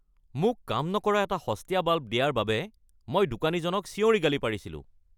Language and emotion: Assamese, angry